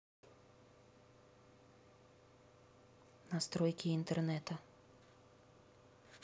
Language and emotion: Russian, neutral